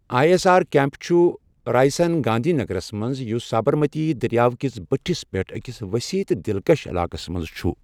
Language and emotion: Kashmiri, neutral